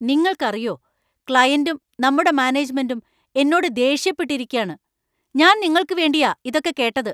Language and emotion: Malayalam, angry